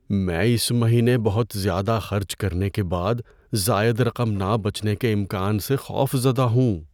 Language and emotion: Urdu, fearful